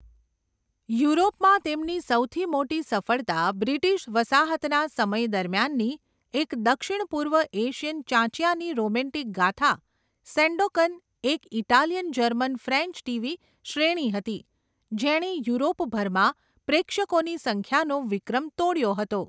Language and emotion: Gujarati, neutral